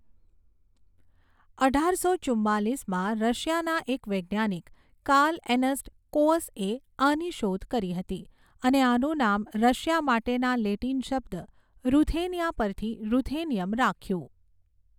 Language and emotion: Gujarati, neutral